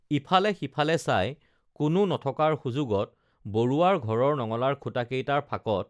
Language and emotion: Assamese, neutral